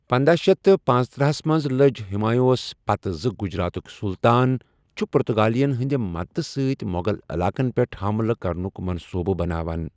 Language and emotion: Kashmiri, neutral